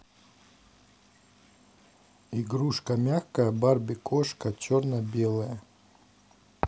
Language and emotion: Russian, neutral